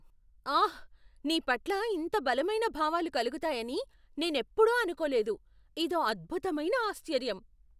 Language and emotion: Telugu, surprised